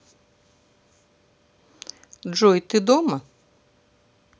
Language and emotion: Russian, neutral